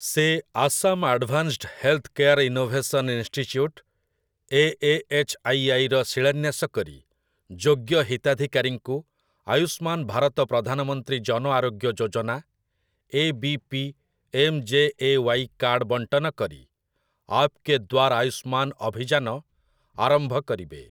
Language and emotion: Odia, neutral